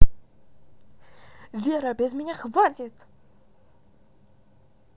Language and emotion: Russian, angry